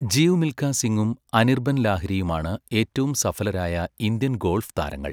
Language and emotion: Malayalam, neutral